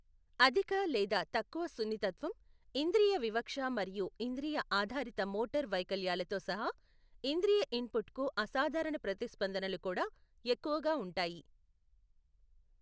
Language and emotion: Telugu, neutral